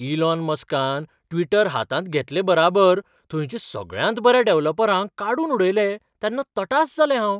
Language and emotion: Goan Konkani, surprised